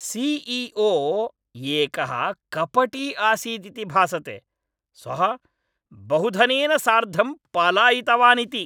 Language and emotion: Sanskrit, angry